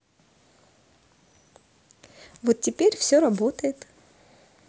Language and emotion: Russian, positive